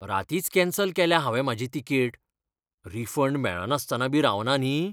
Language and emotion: Goan Konkani, fearful